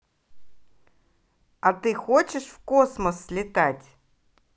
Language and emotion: Russian, positive